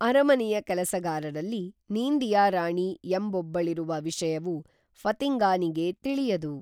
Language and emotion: Kannada, neutral